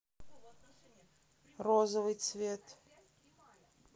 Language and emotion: Russian, neutral